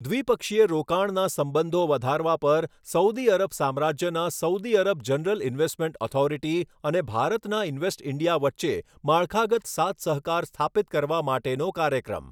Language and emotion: Gujarati, neutral